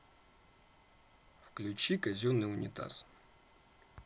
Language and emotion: Russian, neutral